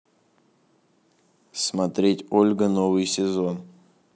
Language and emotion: Russian, neutral